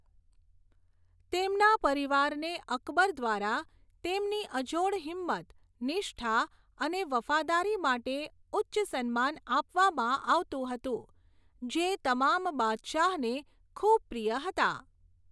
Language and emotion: Gujarati, neutral